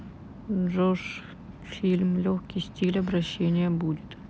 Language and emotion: Russian, neutral